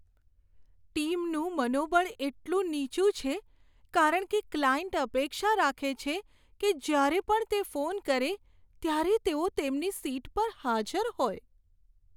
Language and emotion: Gujarati, sad